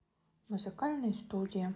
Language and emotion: Russian, neutral